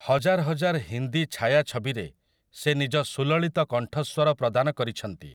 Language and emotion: Odia, neutral